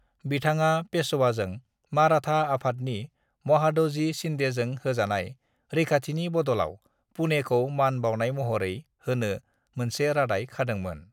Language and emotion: Bodo, neutral